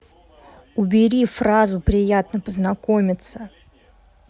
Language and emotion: Russian, angry